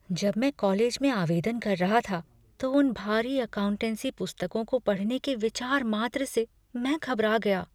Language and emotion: Hindi, fearful